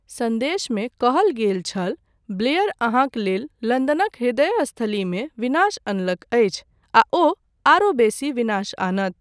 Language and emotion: Maithili, neutral